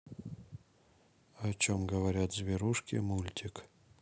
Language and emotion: Russian, neutral